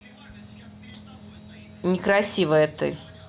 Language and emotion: Russian, angry